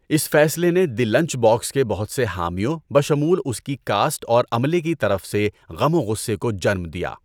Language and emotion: Urdu, neutral